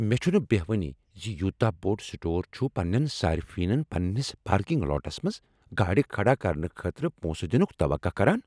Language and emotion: Kashmiri, angry